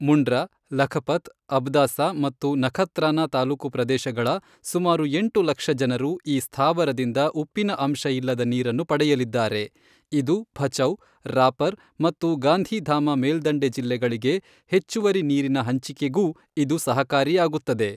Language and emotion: Kannada, neutral